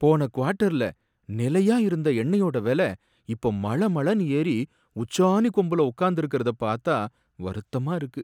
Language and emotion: Tamil, sad